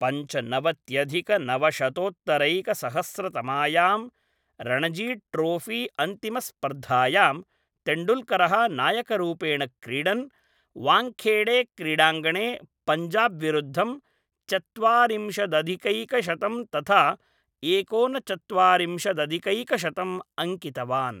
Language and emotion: Sanskrit, neutral